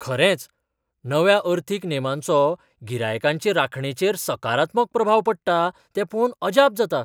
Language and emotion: Goan Konkani, surprised